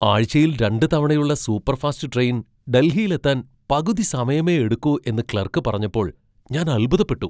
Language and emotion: Malayalam, surprised